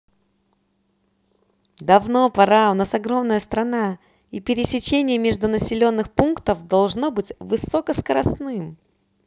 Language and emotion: Russian, positive